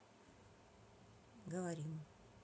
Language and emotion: Russian, neutral